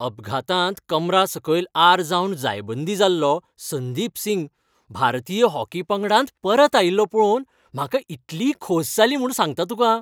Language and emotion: Goan Konkani, happy